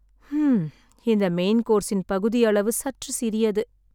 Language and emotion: Tamil, sad